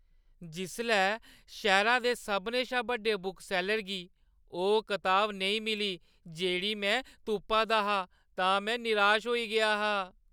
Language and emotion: Dogri, sad